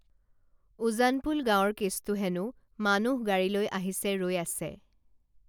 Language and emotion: Assamese, neutral